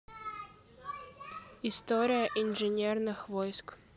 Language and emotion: Russian, neutral